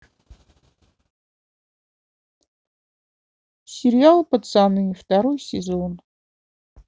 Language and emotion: Russian, sad